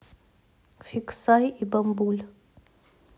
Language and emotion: Russian, neutral